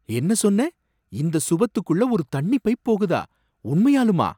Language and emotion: Tamil, surprised